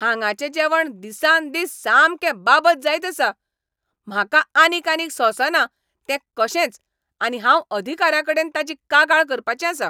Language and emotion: Goan Konkani, angry